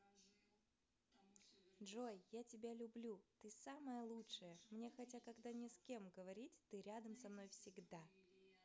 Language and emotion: Russian, positive